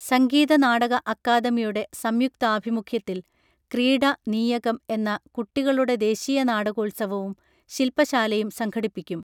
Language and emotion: Malayalam, neutral